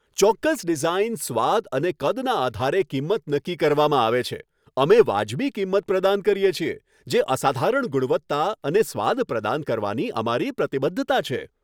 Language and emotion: Gujarati, happy